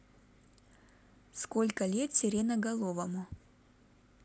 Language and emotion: Russian, neutral